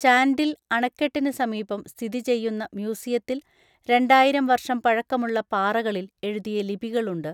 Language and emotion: Malayalam, neutral